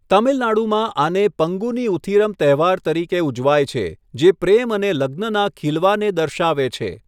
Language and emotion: Gujarati, neutral